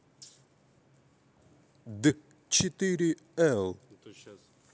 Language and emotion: Russian, neutral